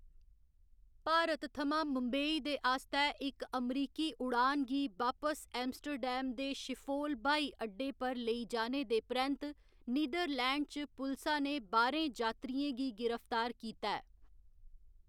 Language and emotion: Dogri, neutral